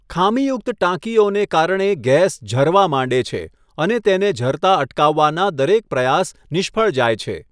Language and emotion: Gujarati, neutral